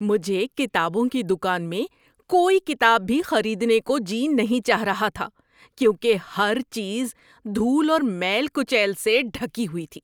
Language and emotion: Urdu, disgusted